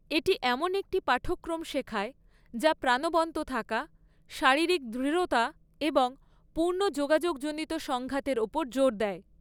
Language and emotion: Bengali, neutral